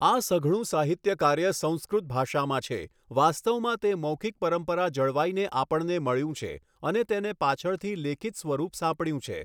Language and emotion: Gujarati, neutral